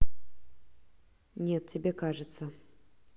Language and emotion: Russian, neutral